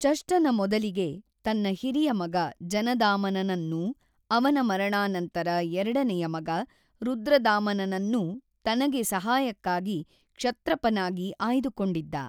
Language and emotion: Kannada, neutral